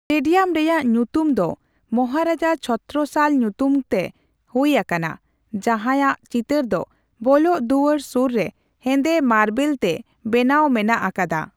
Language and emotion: Santali, neutral